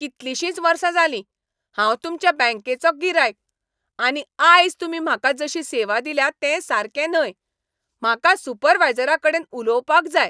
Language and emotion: Goan Konkani, angry